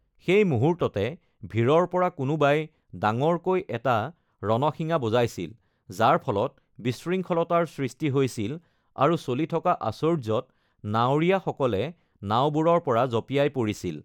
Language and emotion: Assamese, neutral